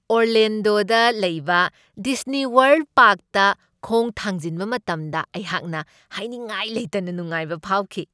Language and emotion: Manipuri, happy